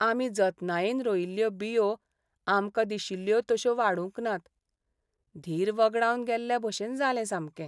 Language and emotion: Goan Konkani, sad